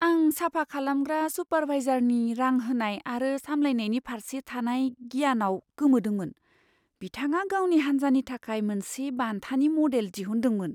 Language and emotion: Bodo, surprised